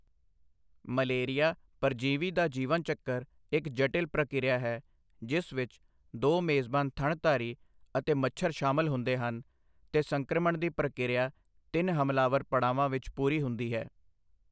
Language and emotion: Punjabi, neutral